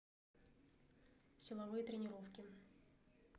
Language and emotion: Russian, neutral